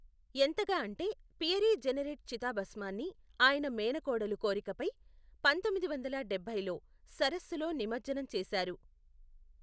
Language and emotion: Telugu, neutral